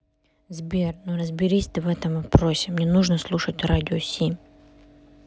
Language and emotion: Russian, neutral